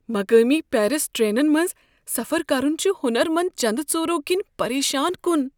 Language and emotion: Kashmiri, fearful